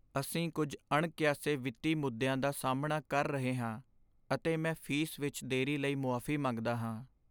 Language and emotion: Punjabi, sad